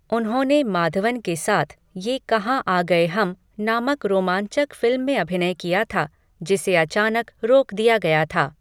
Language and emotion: Hindi, neutral